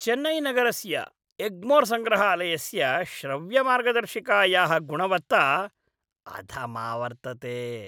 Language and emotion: Sanskrit, disgusted